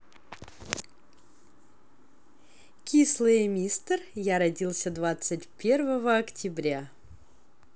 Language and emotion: Russian, positive